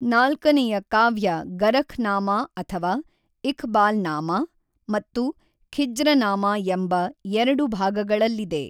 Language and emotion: Kannada, neutral